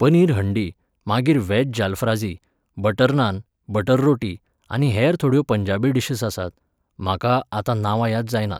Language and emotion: Goan Konkani, neutral